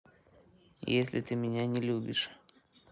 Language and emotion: Russian, neutral